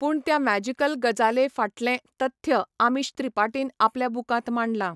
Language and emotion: Goan Konkani, neutral